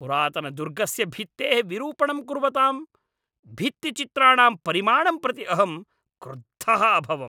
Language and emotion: Sanskrit, angry